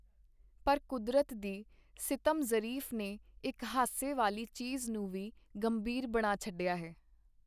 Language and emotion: Punjabi, neutral